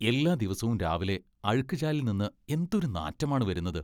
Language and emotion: Malayalam, disgusted